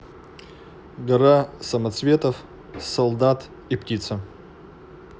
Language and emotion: Russian, neutral